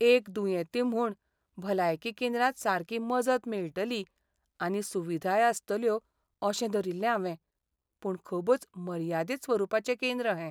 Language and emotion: Goan Konkani, sad